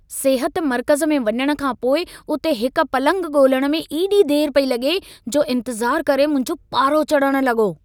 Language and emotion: Sindhi, angry